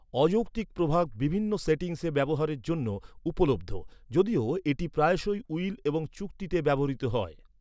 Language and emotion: Bengali, neutral